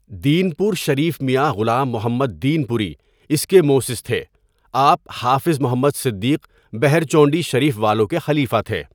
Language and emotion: Urdu, neutral